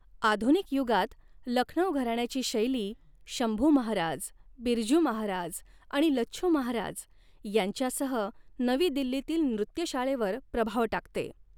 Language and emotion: Marathi, neutral